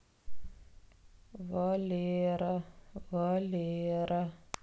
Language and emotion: Russian, sad